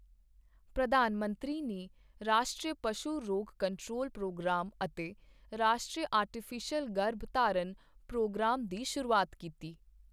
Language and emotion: Punjabi, neutral